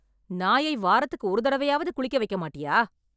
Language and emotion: Tamil, angry